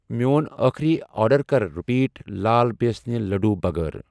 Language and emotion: Kashmiri, neutral